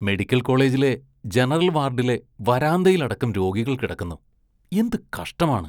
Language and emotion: Malayalam, disgusted